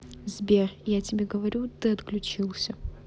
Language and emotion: Russian, neutral